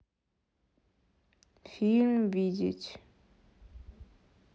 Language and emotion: Russian, neutral